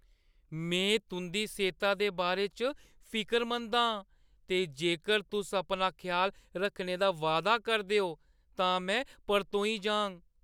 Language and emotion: Dogri, fearful